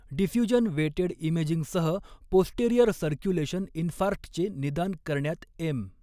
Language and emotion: Marathi, neutral